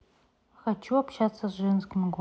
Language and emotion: Russian, neutral